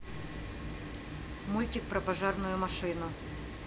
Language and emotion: Russian, neutral